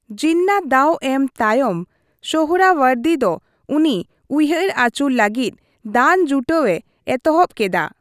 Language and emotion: Santali, neutral